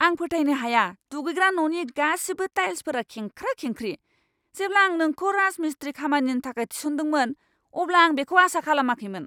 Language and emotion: Bodo, angry